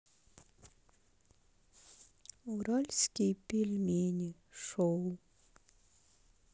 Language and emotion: Russian, sad